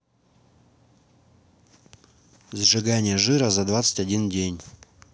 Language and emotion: Russian, neutral